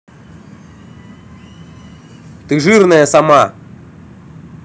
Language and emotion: Russian, angry